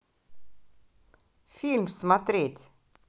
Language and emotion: Russian, positive